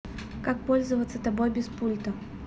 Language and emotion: Russian, neutral